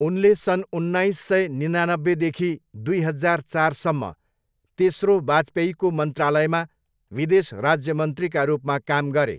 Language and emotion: Nepali, neutral